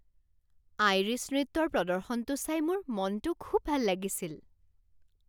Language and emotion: Assamese, happy